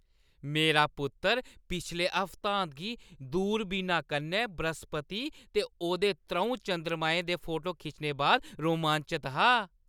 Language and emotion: Dogri, happy